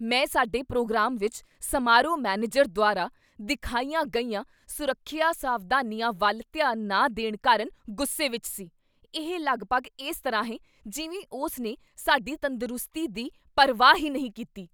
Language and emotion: Punjabi, angry